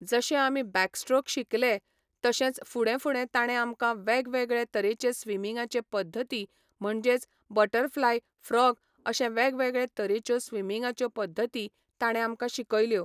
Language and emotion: Goan Konkani, neutral